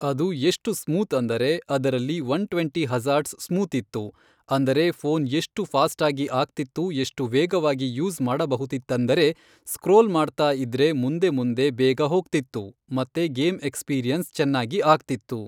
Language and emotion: Kannada, neutral